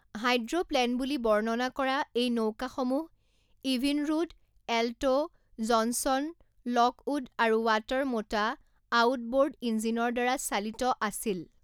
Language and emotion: Assamese, neutral